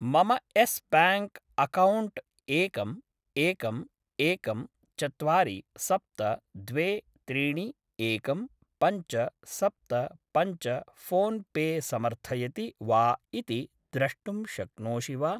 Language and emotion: Sanskrit, neutral